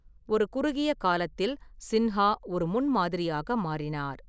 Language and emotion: Tamil, neutral